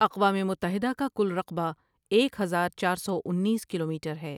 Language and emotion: Urdu, neutral